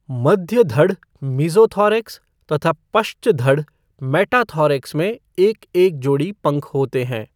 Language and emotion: Hindi, neutral